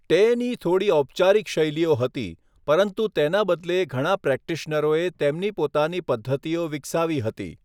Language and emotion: Gujarati, neutral